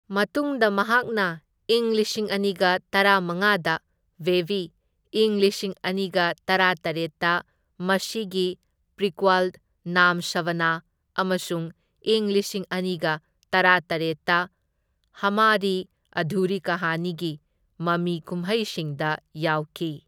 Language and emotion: Manipuri, neutral